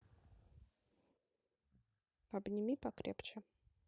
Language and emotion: Russian, neutral